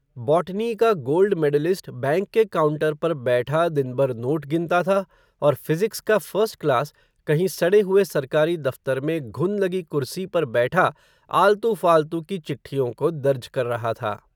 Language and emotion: Hindi, neutral